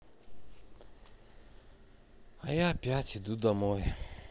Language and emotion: Russian, sad